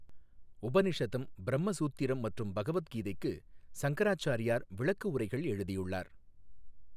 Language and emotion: Tamil, neutral